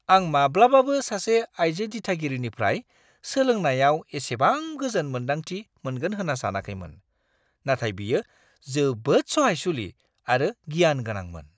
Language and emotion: Bodo, surprised